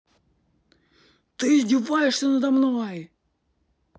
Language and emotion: Russian, angry